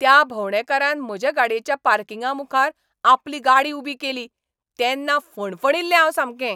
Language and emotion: Goan Konkani, angry